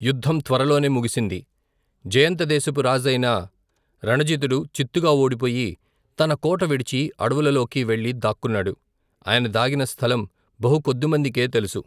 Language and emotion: Telugu, neutral